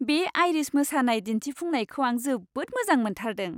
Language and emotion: Bodo, happy